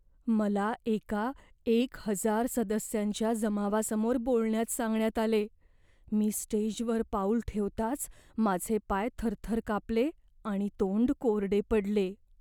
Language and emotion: Marathi, fearful